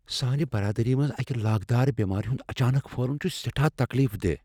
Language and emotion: Kashmiri, fearful